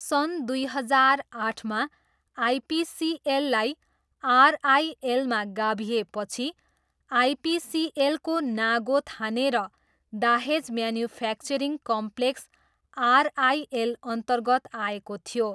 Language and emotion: Nepali, neutral